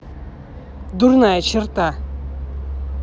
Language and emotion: Russian, angry